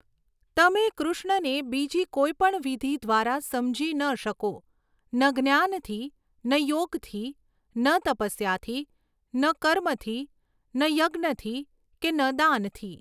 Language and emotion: Gujarati, neutral